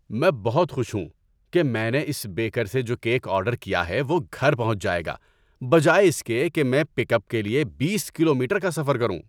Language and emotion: Urdu, happy